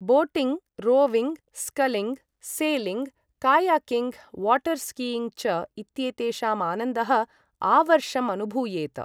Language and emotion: Sanskrit, neutral